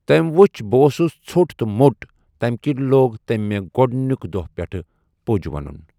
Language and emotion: Kashmiri, neutral